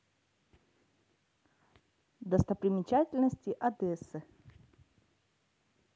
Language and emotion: Russian, neutral